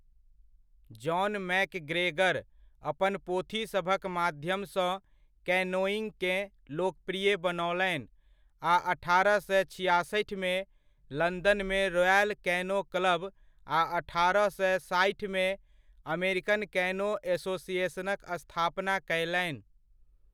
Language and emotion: Maithili, neutral